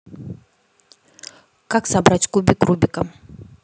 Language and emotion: Russian, neutral